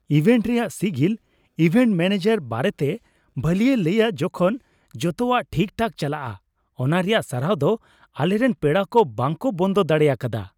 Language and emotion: Santali, happy